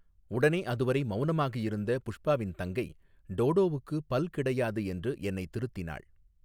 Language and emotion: Tamil, neutral